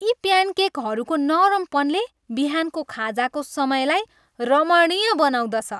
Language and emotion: Nepali, happy